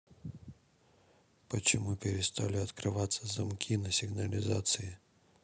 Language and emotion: Russian, neutral